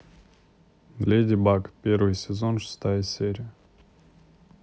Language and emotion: Russian, neutral